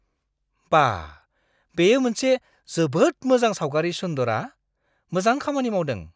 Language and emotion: Bodo, surprised